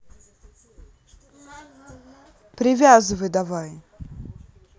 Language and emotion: Russian, angry